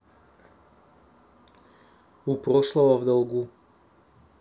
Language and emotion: Russian, neutral